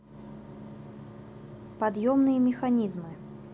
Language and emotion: Russian, neutral